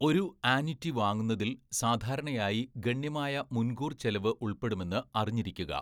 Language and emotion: Malayalam, neutral